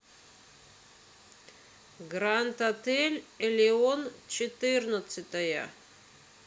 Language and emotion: Russian, neutral